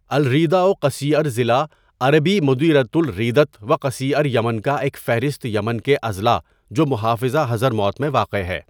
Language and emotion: Urdu, neutral